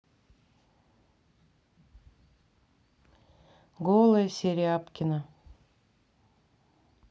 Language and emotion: Russian, neutral